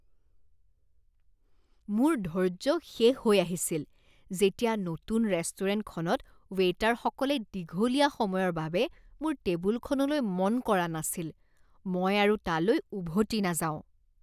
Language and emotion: Assamese, disgusted